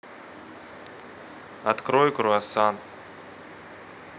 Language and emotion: Russian, neutral